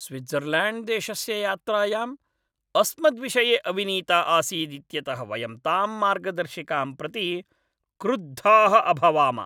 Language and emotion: Sanskrit, angry